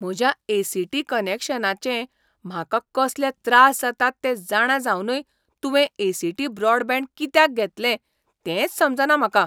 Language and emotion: Goan Konkani, surprised